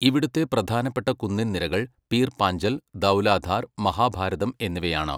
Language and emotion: Malayalam, neutral